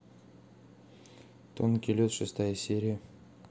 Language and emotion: Russian, neutral